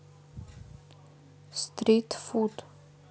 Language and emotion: Russian, neutral